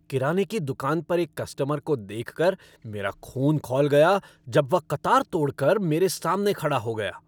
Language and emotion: Hindi, angry